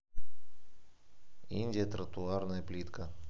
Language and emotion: Russian, neutral